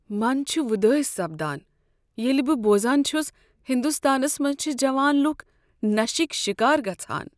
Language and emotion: Kashmiri, sad